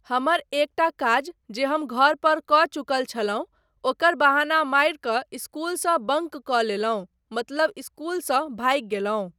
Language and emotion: Maithili, neutral